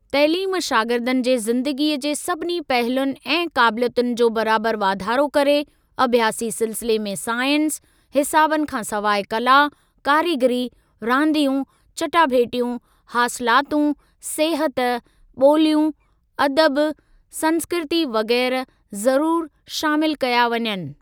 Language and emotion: Sindhi, neutral